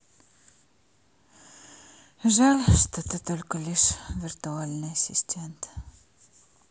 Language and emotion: Russian, sad